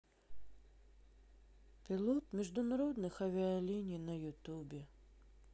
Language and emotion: Russian, sad